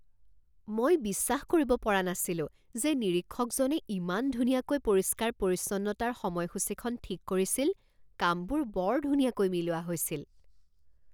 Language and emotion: Assamese, surprised